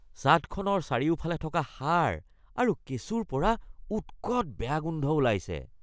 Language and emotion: Assamese, disgusted